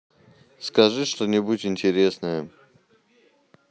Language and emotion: Russian, neutral